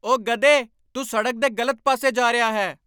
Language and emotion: Punjabi, angry